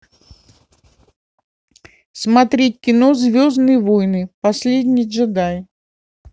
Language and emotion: Russian, neutral